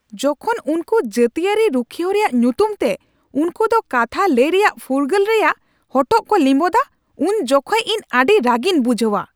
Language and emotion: Santali, angry